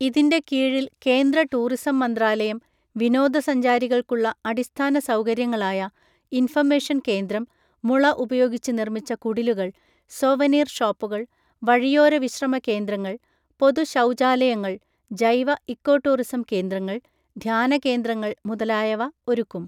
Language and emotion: Malayalam, neutral